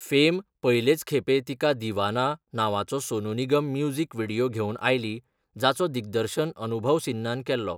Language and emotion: Goan Konkani, neutral